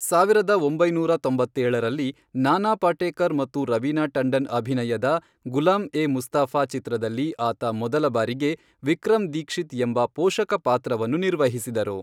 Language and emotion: Kannada, neutral